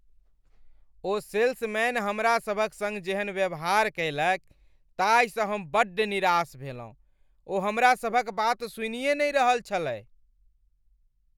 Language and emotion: Maithili, angry